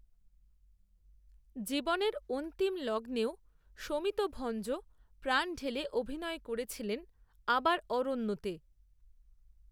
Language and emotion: Bengali, neutral